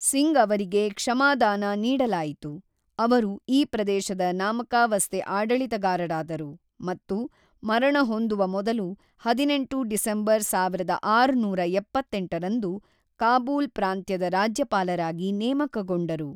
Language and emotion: Kannada, neutral